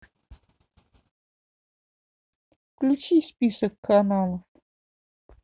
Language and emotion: Russian, neutral